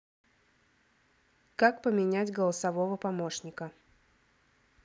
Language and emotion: Russian, neutral